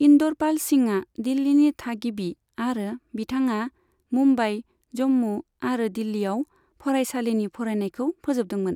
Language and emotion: Bodo, neutral